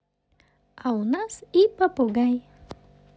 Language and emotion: Russian, positive